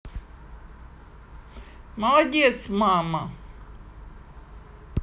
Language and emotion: Russian, positive